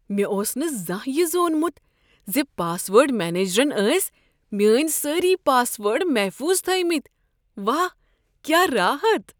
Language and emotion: Kashmiri, surprised